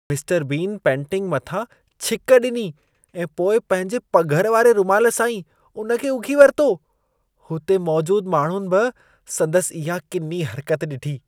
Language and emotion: Sindhi, disgusted